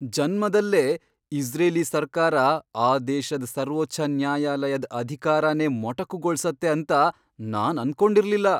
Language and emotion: Kannada, surprised